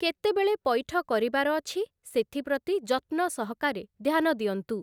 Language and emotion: Odia, neutral